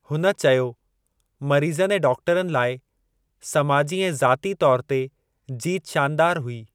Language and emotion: Sindhi, neutral